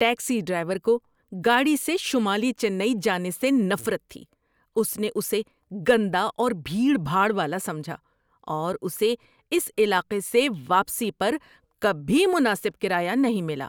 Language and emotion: Urdu, disgusted